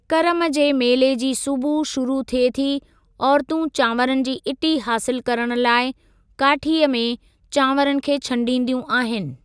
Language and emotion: Sindhi, neutral